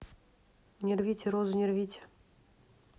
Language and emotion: Russian, neutral